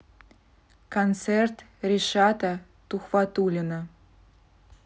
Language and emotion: Russian, neutral